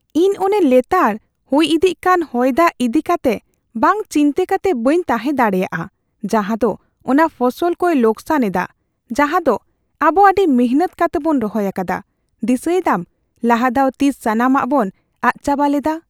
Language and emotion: Santali, fearful